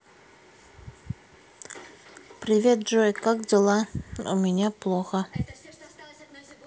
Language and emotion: Russian, sad